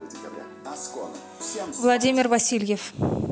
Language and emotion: Russian, neutral